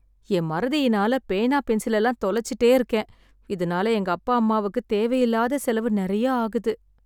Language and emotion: Tamil, sad